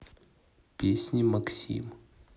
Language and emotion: Russian, neutral